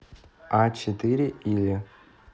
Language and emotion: Russian, neutral